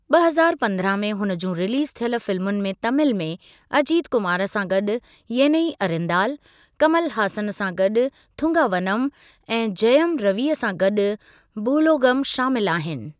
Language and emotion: Sindhi, neutral